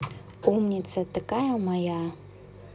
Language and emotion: Russian, positive